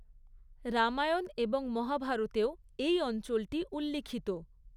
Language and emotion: Bengali, neutral